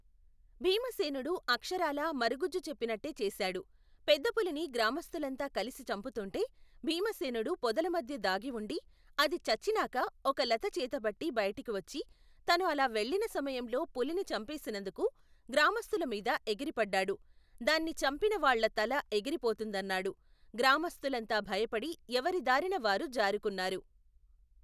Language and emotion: Telugu, neutral